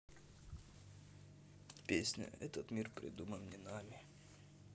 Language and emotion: Russian, sad